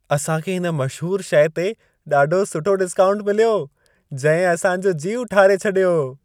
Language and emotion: Sindhi, happy